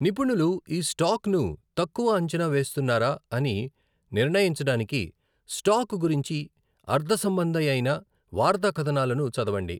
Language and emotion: Telugu, neutral